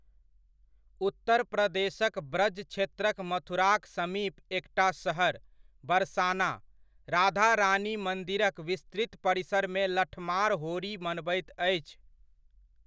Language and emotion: Maithili, neutral